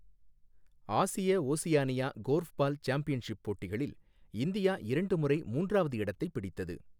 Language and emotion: Tamil, neutral